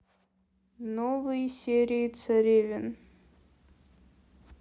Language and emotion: Russian, neutral